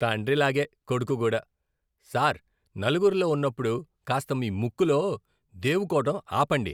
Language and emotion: Telugu, disgusted